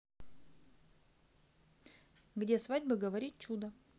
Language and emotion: Russian, neutral